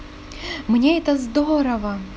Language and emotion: Russian, positive